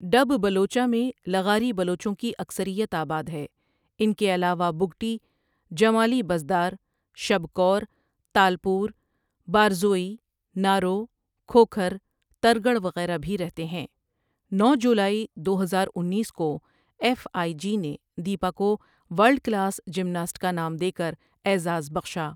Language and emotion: Urdu, neutral